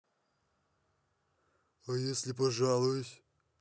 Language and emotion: Russian, neutral